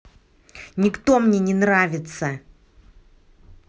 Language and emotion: Russian, angry